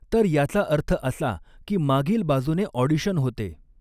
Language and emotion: Marathi, neutral